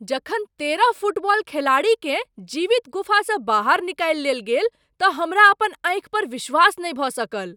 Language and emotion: Maithili, surprised